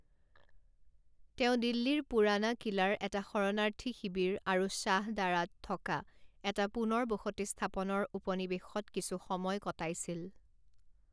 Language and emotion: Assamese, neutral